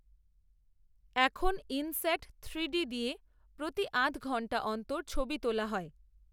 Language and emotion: Bengali, neutral